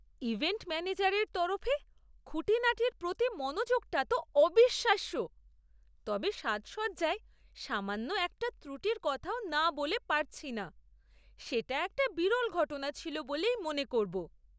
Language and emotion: Bengali, surprised